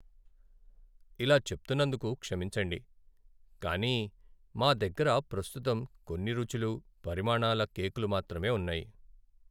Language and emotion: Telugu, sad